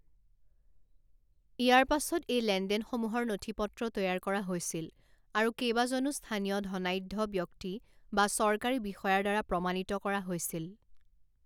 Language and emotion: Assamese, neutral